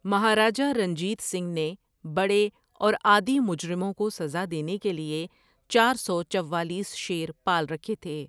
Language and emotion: Urdu, neutral